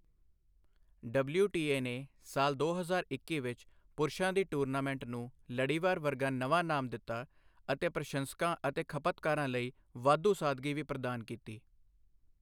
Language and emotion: Punjabi, neutral